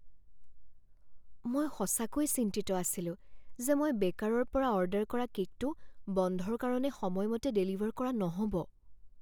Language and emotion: Assamese, fearful